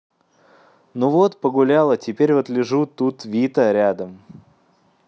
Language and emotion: Russian, neutral